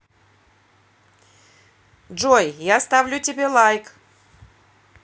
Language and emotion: Russian, positive